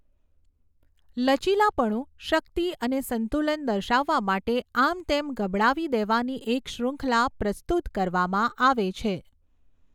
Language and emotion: Gujarati, neutral